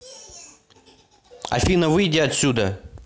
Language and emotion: Russian, angry